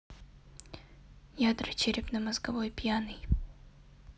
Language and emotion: Russian, neutral